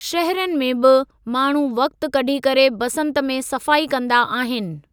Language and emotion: Sindhi, neutral